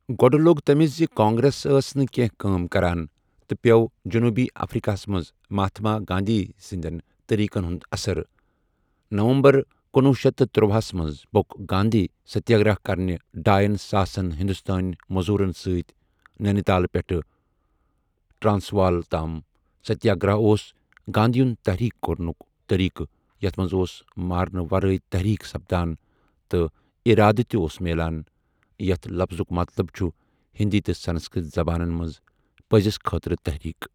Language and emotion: Kashmiri, neutral